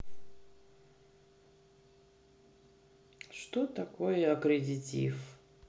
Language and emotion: Russian, sad